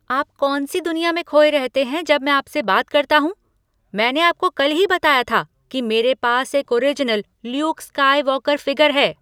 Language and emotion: Hindi, angry